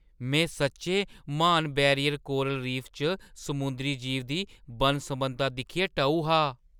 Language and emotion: Dogri, surprised